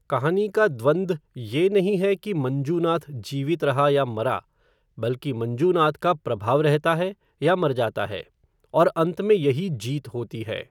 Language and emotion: Hindi, neutral